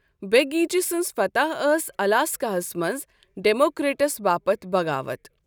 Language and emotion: Kashmiri, neutral